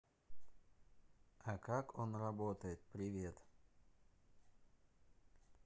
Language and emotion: Russian, neutral